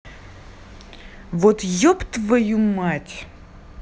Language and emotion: Russian, angry